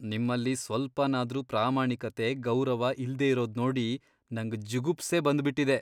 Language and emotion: Kannada, disgusted